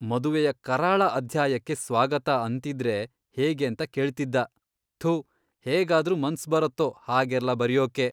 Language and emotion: Kannada, disgusted